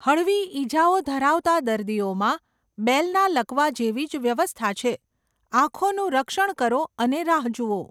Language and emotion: Gujarati, neutral